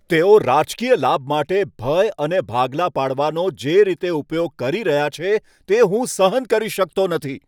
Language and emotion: Gujarati, angry